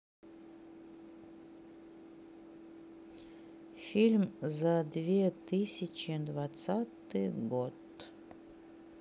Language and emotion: Russian, sad